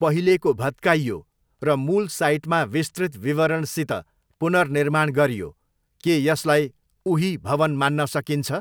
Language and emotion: Nepali, neutral